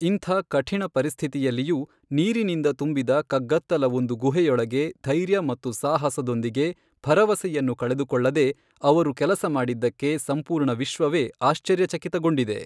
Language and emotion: Kannada, neutral